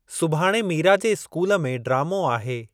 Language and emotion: Sindhi, neutral